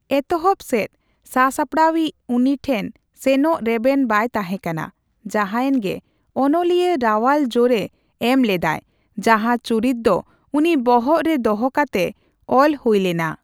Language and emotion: Santali, neutral